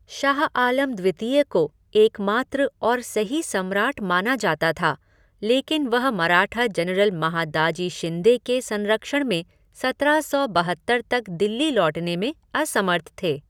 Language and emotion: Hindi, neutral